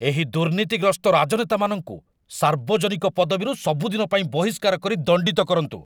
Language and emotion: Odia, angry